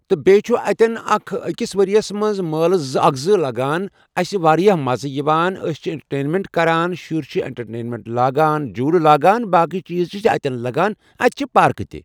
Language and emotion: Kashmiri, neutral